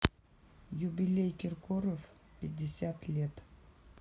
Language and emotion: Russian, neutral